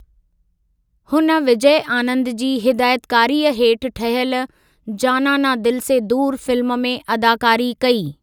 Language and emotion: Sindhi, neutral